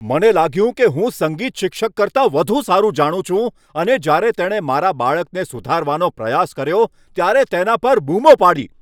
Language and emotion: Gujarati, angry